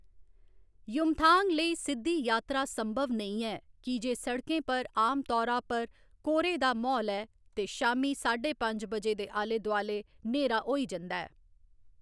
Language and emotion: Dogri, neutral